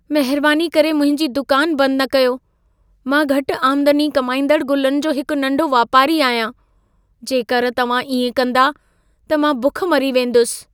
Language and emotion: Sindhi, fearful